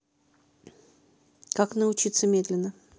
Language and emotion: Russian, neutral